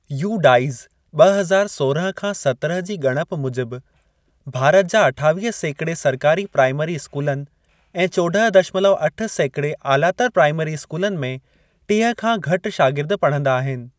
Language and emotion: Sindhi, neutral